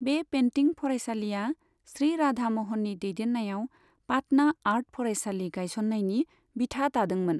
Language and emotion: Bodo, neutral